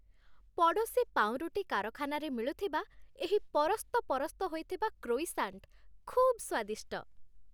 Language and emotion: Odia, happy